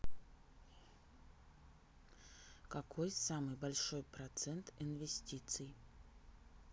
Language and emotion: Russian, neutral